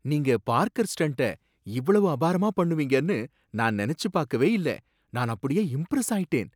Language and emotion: Tamil, surprised